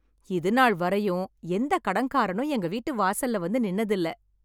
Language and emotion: Tamil, happy